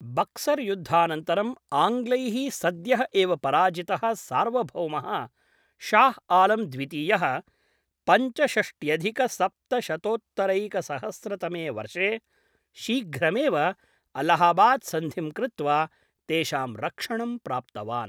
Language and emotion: Sanskrit, neutral